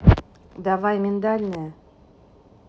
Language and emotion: Russian, neutral